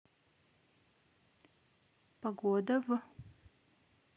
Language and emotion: Russian, neutral